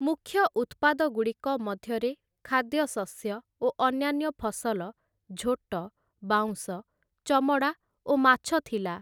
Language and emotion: Odia, neutral